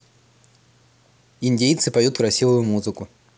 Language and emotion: Russian, neutral